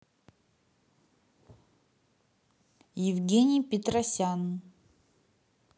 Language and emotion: Russian, neutral